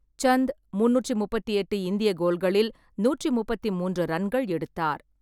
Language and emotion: Tamil, neutral